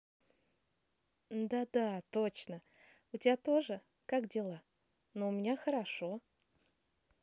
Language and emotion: Russian, positive